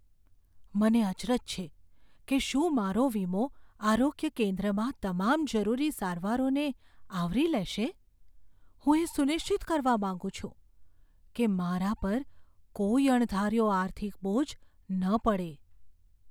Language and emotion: Gujarati, fearful